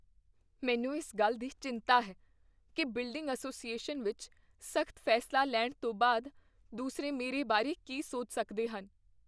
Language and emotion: Punjabi, fearful